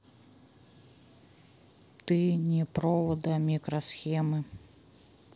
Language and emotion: Russian, neutral